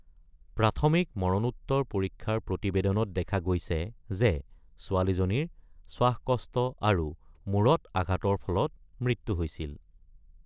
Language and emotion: Assamese, neutral